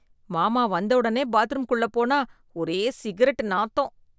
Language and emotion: Tamil, disgusted